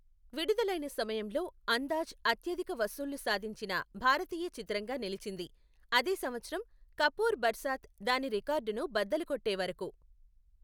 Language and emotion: Telugu, neutral